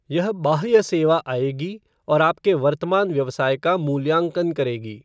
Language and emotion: Hindi, neutral